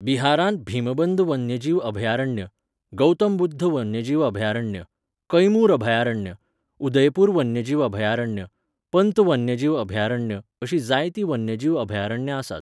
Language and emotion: Goan Konkani, neutral